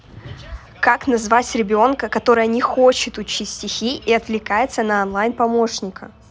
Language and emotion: Russian, angry